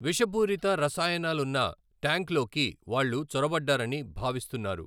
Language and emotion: Telugu, neutral